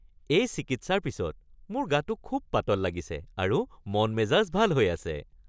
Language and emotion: Assamese, happy